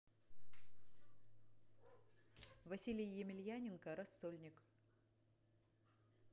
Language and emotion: Russian, neutral